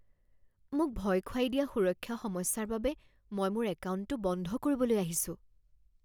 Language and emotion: Assamese, fearful